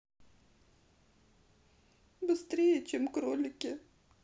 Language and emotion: Russian, sad